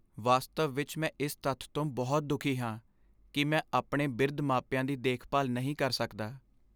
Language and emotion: Punjabi, sad